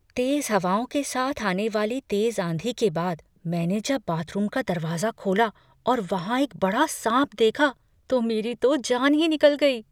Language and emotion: Hindi, fearful